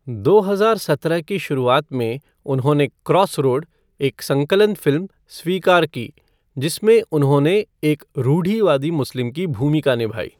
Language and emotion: Hindi, neutral